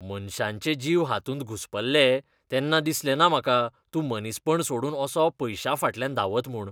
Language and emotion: Goan Konkani, disgusted